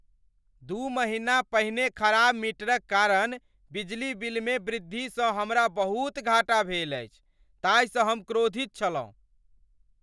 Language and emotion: Maithili, angry